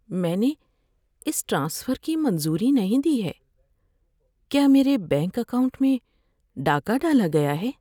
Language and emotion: Urdu, fearful